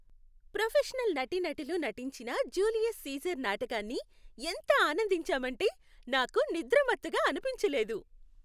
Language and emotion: Telugu, happy